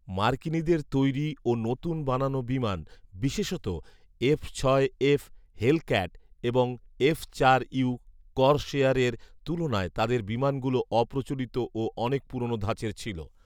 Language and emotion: Bengali, neutral